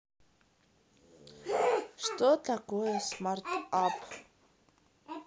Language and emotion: Russian, neutral